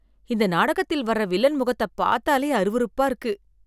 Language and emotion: Tamil, disgusted